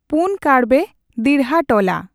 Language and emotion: Santali, neutral